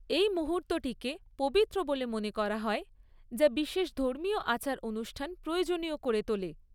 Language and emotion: Bengali, neutral